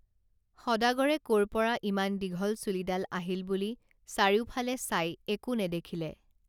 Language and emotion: Assamese, neutral